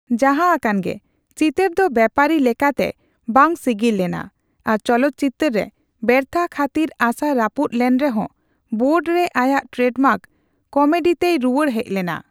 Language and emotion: Santali, neutral